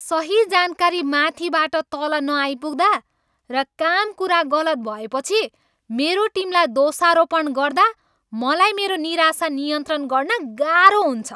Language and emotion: Nepali, angry